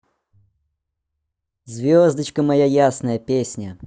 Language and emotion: Russian, positive